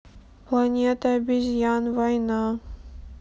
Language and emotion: Russian, sad